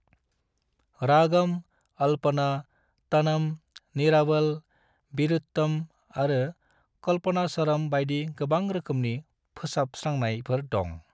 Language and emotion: Bodo, neutral